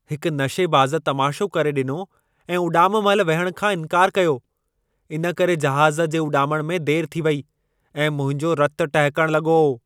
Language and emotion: Sindhi, angry